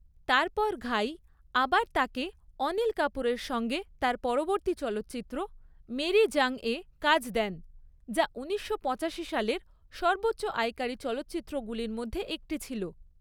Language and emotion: Bengali, neutral